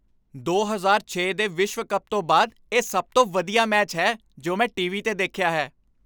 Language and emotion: Punjabi, happy